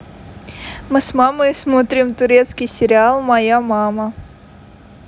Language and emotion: Russian, positive